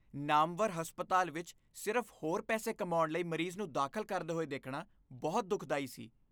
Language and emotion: Punjabi, disgusted